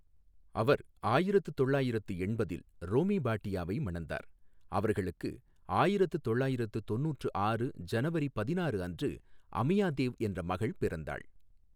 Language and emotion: Tamil, neutral